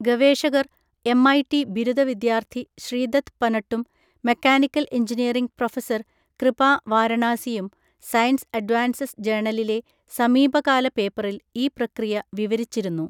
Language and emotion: Malayalam, neutral